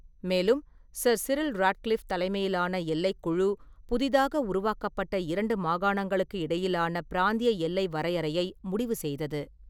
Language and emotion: Tamil, neutral